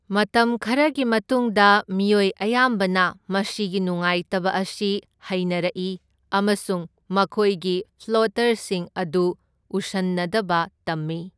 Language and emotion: Manipuri, neutral